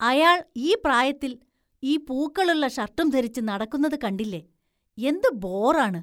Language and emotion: Malayalam, disgusted